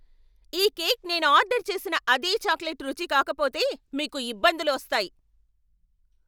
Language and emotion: Telugu, angry